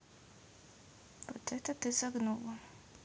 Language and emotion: Russian, neutral